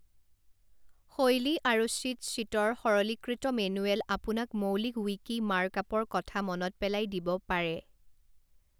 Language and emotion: Assamese, neutral